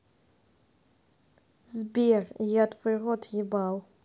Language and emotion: Russian, neutral